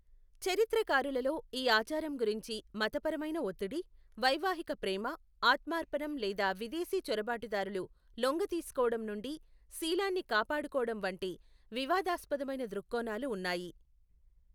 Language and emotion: Telugu, neutral